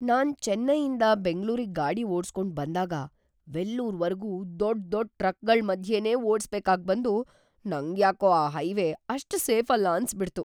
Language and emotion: Kannada, fearful